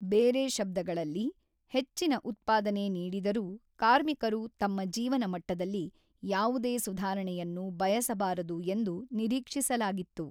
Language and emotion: Kannada, neutral